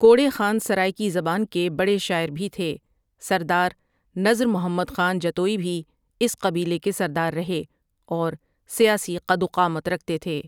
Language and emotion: Urdu, neutral